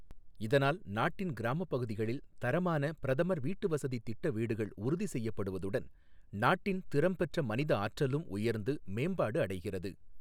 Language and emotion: Tamil, neutral